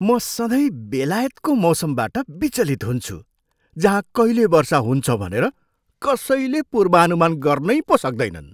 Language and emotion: Nepali, surprised